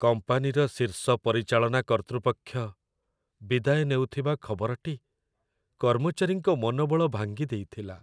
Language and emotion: Odia, sad